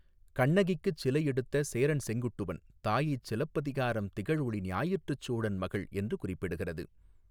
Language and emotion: Tamil, neutral